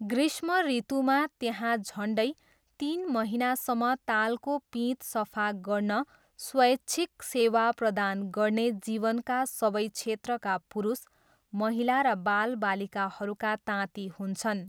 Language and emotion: Nepali, neutral